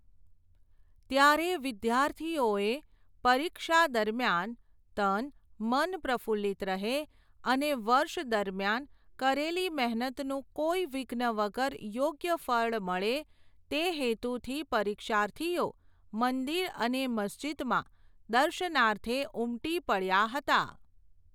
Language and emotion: Gujarati, neutral